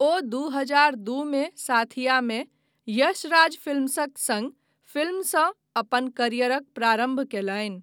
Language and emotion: Maithili, neutral